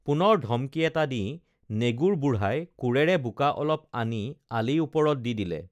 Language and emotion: Assamese, neutral